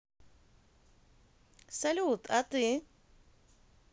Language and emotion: Russian, positive